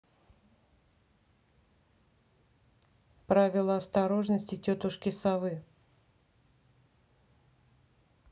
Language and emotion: Russian, neutral